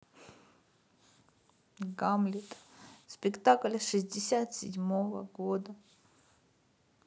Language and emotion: Russian, sad